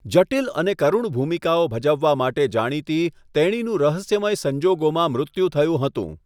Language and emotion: Gujarati, neutral